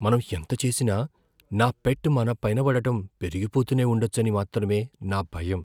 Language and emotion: Telugu, fearful